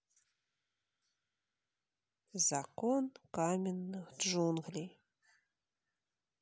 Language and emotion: Russian, neutral